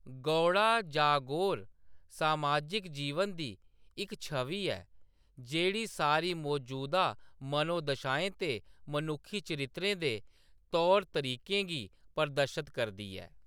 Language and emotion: Dogri, neutral